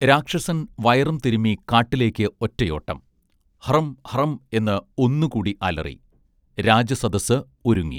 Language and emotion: Malayalam, neutral